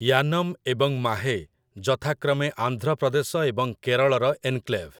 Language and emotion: Odia, neutral